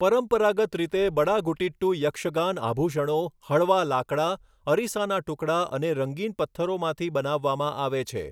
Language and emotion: Gujarati, neutral